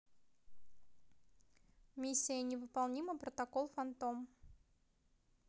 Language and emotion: Russian, neutral